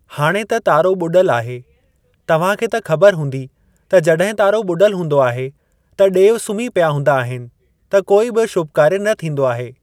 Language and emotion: Sindhi, neutral